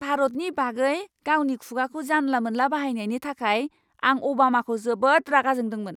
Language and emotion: Bodo, angry